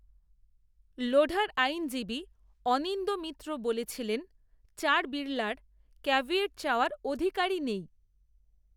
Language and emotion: Bengali, neutral